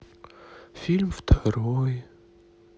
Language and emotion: Russian, sad